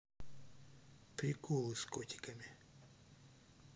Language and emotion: Russian, neutral